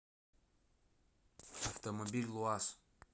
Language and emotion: Russian, neutral